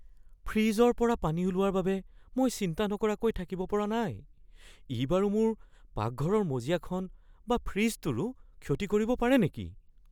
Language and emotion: Assamese, fearful